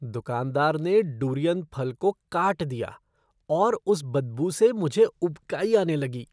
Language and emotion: Hindi, disgusted